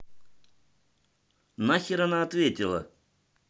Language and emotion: Russian, angry